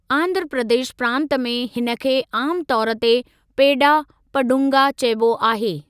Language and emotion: Sindhi, neutral